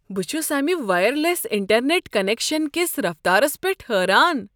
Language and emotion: Kashmiri, surprised